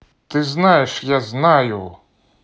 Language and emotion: Russian, neutral